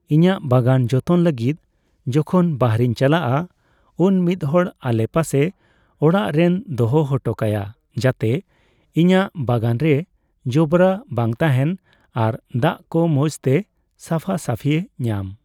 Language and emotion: Santali, neutral